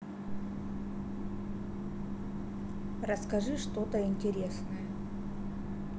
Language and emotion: Russian, neutral